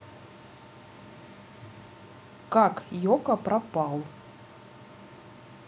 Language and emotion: Russian, neutral